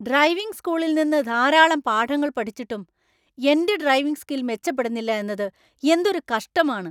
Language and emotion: Malayalam, angry